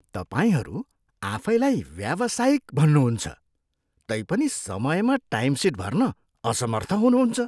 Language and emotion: Nepali, disgusted